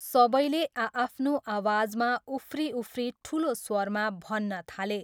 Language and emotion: Nepali, neutral